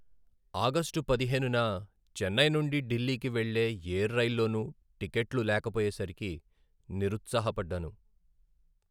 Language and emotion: Telugu, sad